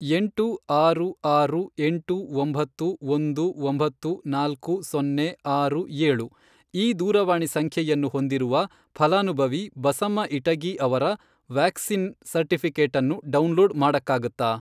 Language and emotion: Kannada, neutral